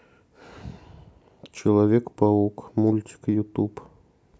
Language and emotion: Russian, sad